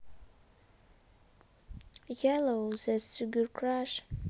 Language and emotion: Russian, neutral